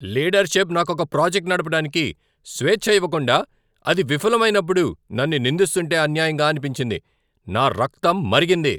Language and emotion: Telugu, angry